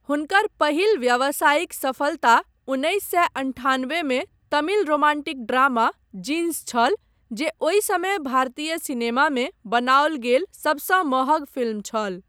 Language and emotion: Maithili, neutral